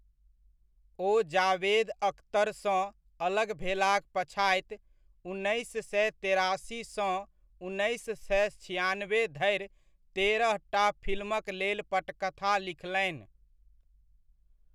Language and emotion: Maithili, neutral